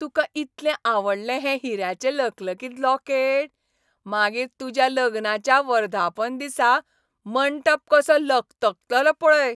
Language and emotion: Goan Konkani, happy